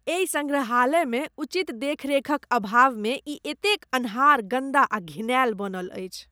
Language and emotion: Maithili, disgusted